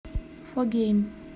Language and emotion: Russian, neutral